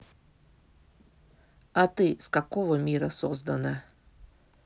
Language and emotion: Russian, neutral